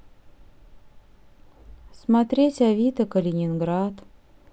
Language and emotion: Russian, sad